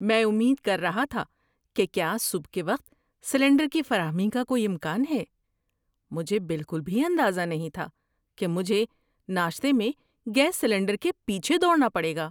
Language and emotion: Urdu, surprised